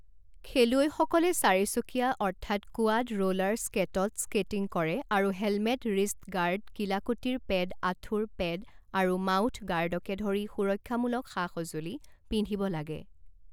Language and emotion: Assamese, neutral